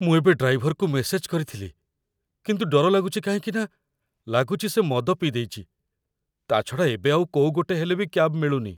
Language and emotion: Odia, fearful